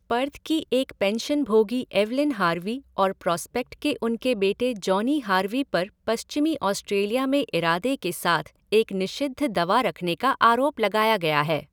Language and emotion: Hindi, neutral